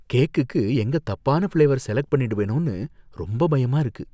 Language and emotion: Tamil, fearful